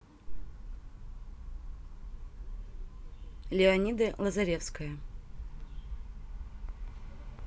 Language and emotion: Russian, neutral